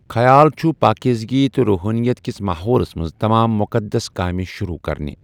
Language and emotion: Kashmiri, neutral